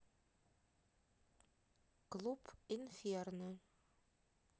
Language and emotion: Russian, neutral